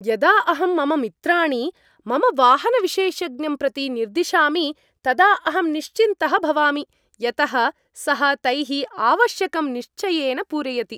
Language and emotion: Sanskrit, happy